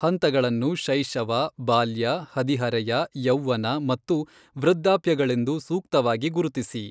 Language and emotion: Kannada, neutral